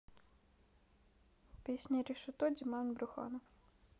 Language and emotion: Russian, neutral